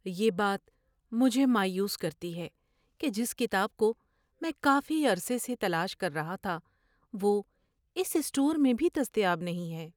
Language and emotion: Urdu, sad